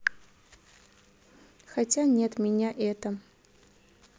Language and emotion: Russian, neutral